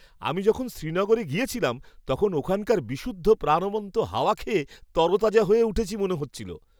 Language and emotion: Bengali, happy